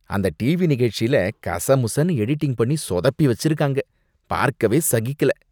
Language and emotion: Tamil, disgusted